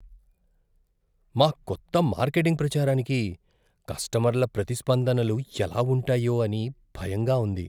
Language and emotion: Telugu, fearful